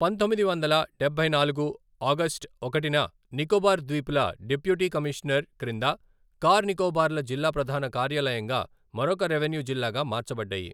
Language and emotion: Telugu, neutral